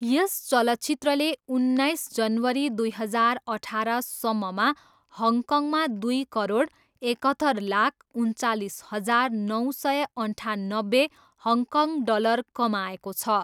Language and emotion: Nepali, neutral